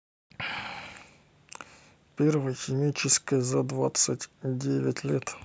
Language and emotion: Russian, neutral